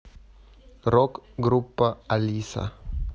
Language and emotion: Russian, neutral